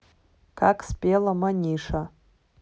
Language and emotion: Russian, neutral